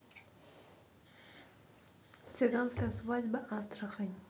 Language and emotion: Russian, neutral